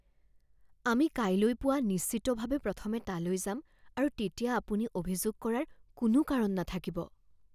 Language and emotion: Assamese, fearful